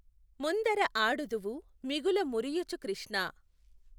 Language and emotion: Telugu, neutral